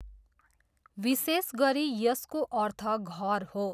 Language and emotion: Nepali, neutral